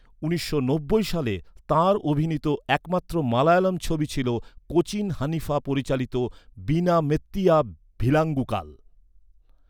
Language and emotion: Bengali, neutral